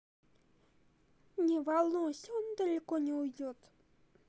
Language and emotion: Russian, neutral